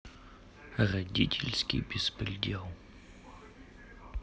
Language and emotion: Russian, sad